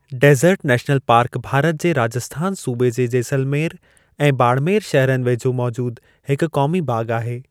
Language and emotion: Sindhi, neutral